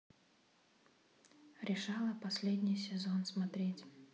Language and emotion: Russian, neutral